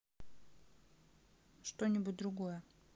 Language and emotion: Russian, neutral